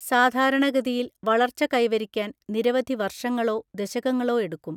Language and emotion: Malayalam, neutral